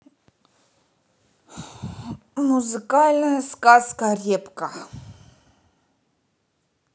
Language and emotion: Russian, angry